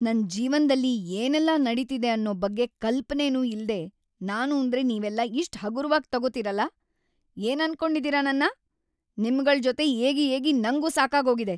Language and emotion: Kannada, angry